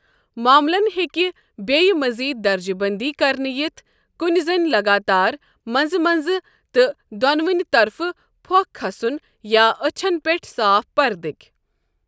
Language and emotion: Kashmiri, neutral